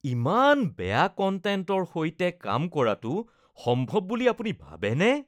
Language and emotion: Assamese, disgusted